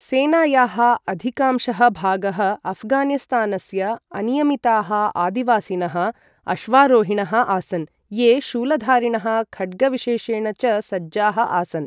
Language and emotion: Sanskrit, neutral